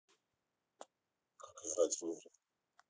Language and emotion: Russian, neutral